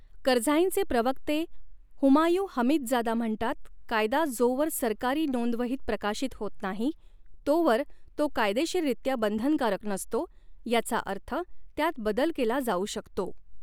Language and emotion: Marathi, neutral